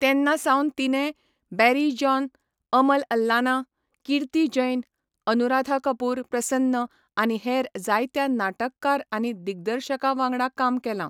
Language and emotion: Goan Konkani, neutral